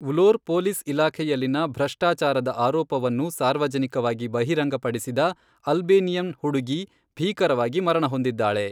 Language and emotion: Kannada, neutral